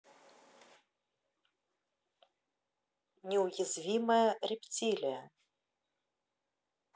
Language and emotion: Russian, neutral